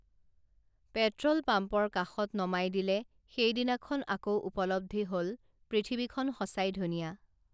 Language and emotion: Assamese, neutral